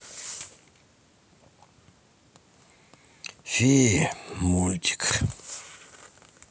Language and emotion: Russian, sad